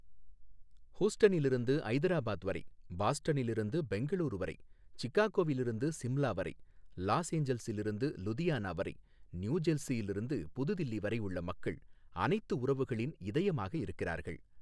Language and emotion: Tamil, neutral